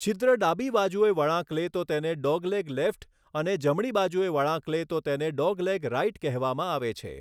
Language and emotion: Gujarati, neutral